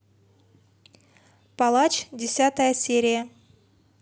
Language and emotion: Russian, neutral